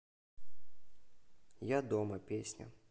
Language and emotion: Russian, neutral